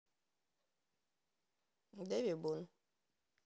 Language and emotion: Russian, neutral